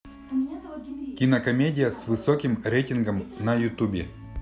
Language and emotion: Russian, neutral